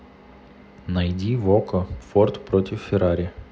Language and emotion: Russian, neutral